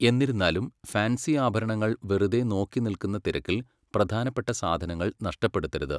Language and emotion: Malayalam, neutral